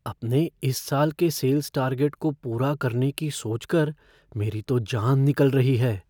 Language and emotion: Hindi, fearful